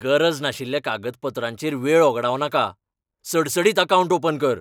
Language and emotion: Goan Konkani, angry